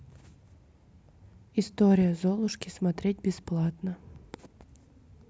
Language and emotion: Russian, neutral